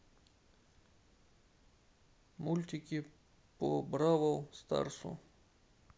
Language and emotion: Russian, neutral